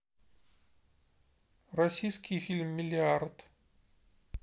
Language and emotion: Russian, neutral